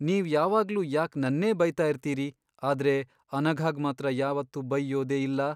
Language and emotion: Kannada, sad